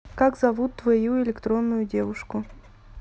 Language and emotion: Russian, neutral